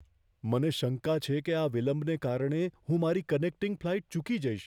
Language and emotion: Gujarati, fearful